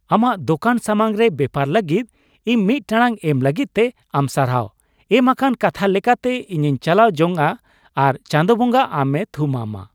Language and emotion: Santali, happy